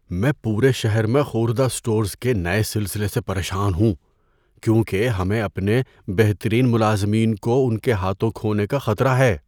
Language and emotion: Urdu, fearful